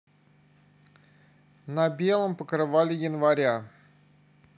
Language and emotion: Russian, neutral